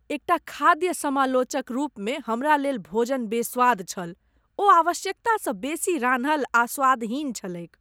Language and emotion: Maithili, disgusted